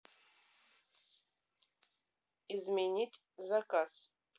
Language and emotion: Russian, neutral